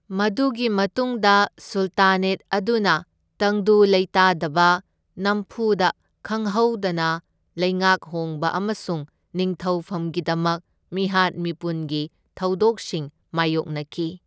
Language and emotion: Manipuri, neutral